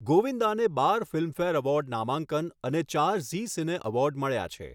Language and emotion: Gujarati, neutral